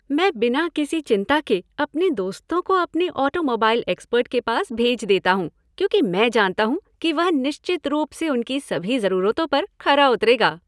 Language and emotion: Hindi, happy